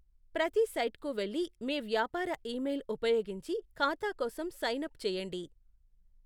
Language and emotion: Telugu, neutral